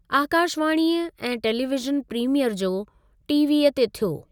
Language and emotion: Sindhi, neutral